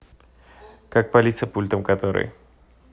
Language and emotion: Russian, neutral